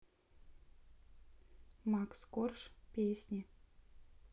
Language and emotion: Russian, neutral